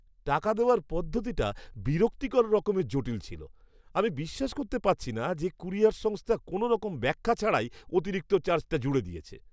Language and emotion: Bengali, disgusted